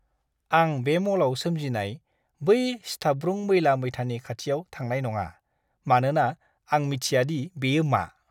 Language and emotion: Bodo, disgusted